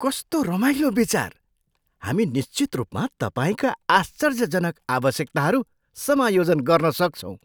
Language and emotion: Nepali, surprised